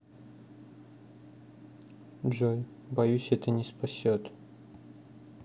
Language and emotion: Russian, neutral